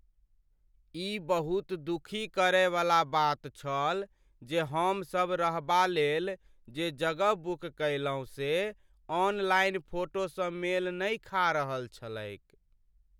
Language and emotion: Maithili, sad